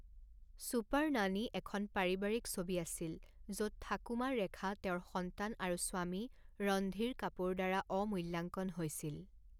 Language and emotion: Assamese, neutral